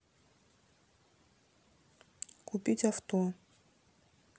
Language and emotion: Russian, neutral